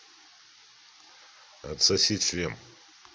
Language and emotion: Russian, neutral